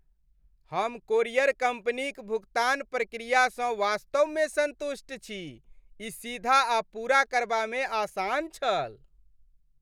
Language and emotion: Maithili, happy